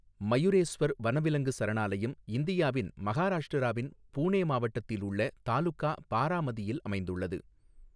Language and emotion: Tamil, neutral